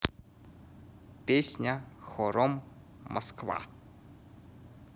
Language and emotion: Russian, neutral